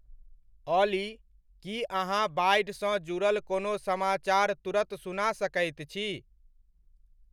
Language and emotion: Maithili, neutral